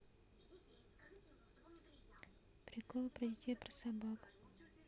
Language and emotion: Russian, neutral